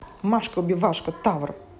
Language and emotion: Russian, angry